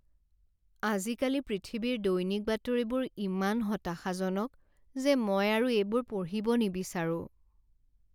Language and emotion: Assamese, sad